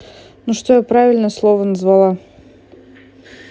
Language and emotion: Russian, neutral